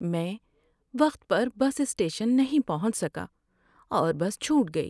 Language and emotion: Urdu, sad